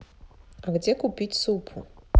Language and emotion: Russian, neutral